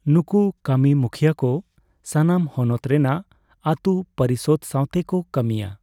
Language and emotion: Santali, neutral